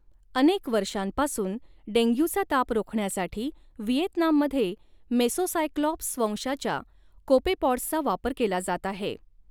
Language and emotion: Marathi, neutral